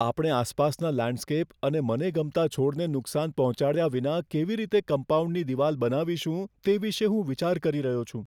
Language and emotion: Gujarati, fearful